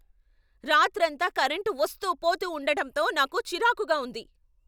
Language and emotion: Telugu, angry